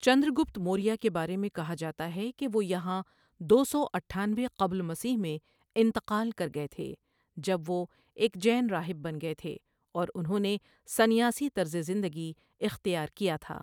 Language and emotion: Urdu, neutral